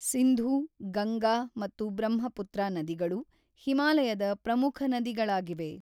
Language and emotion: Kannada, neutral